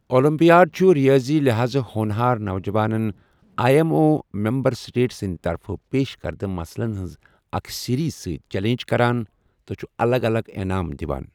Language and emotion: Kashmiri, neutral